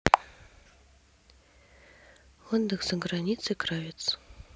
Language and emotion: Russian, neutral